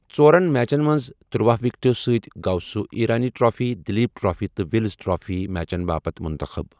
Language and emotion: Kashmiri, neutral